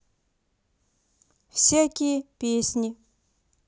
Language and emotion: Russian, neutral